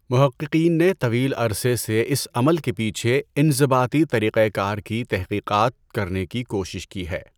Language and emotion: Urdu, neutral